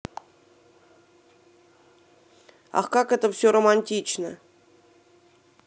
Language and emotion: Russian, neutral